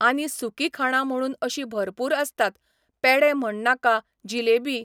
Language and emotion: Goan Konkani, neutral